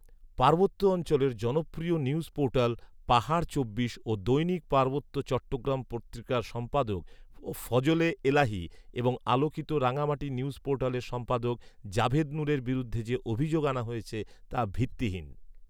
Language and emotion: Bengali, neutral